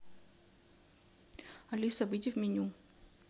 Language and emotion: Russian, neutral